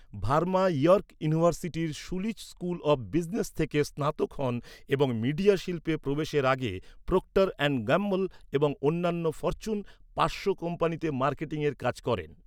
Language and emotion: Bengali, neutral